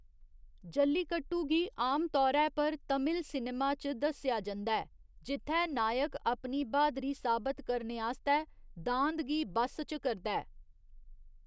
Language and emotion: Dogri, neutral